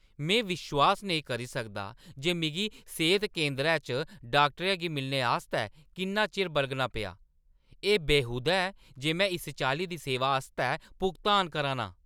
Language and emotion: Dogri, angry